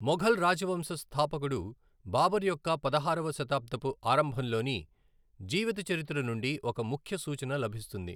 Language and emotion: Telugu, neutral